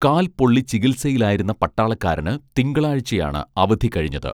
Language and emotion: Malayalam, neutral